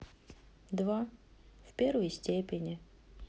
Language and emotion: Russian, sad